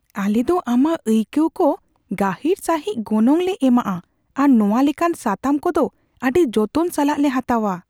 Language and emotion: Santali, fearful